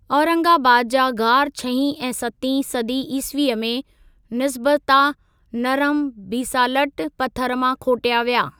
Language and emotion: Sindhi, neutral